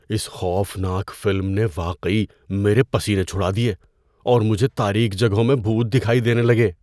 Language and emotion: Urdu, fearful